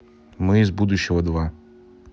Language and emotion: Russian, neutral